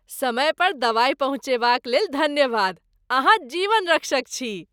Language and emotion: Maithili, happy